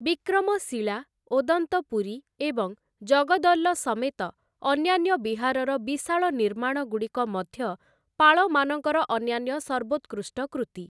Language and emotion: Odia, neutral